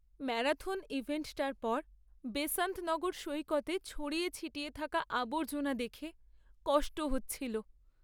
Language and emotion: Bengali, sad